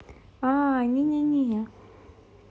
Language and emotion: Russian, neutral